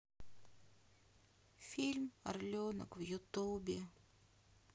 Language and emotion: Russian, sad